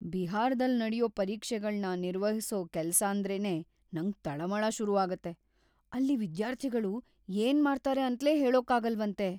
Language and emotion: Kannada, fearful